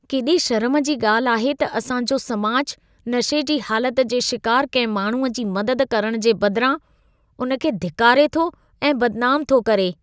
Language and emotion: Sindhi, disgusted